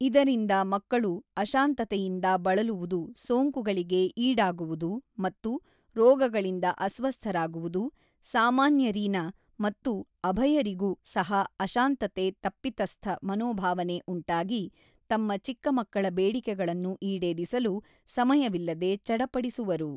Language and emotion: Kannada, neutral